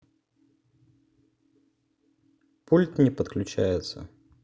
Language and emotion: Russian, neutral